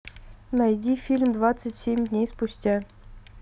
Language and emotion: Russian, neutral